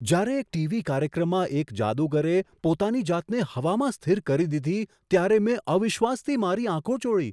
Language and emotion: Gujarati, surprised